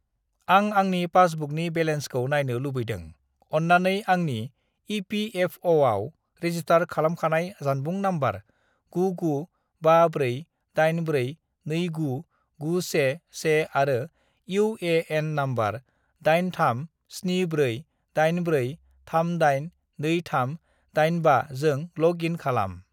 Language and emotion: Bodo, neutral